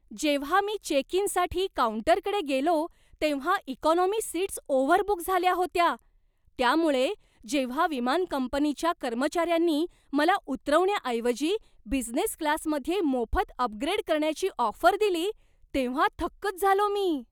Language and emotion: Marathi, surprised